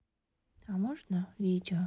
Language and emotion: Russian, sad